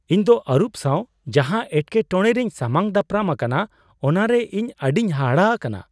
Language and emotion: Santali, surprised